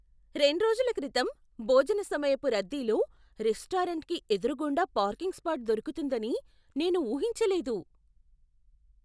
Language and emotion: Telugu, surprised